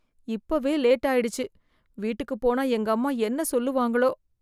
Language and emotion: Tamil, fearful